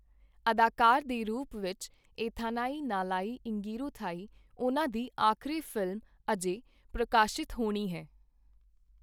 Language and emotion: Punjabi, neutral